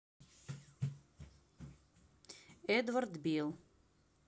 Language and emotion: Russian, neutral